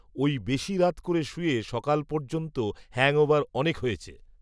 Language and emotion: Bengali, neutral